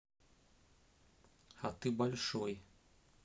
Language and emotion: Russian, neutral